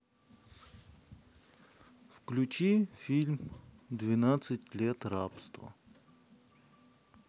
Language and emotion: Russian, neutral